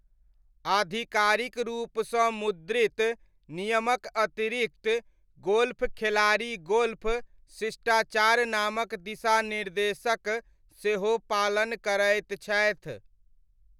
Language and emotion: Maithili, neutral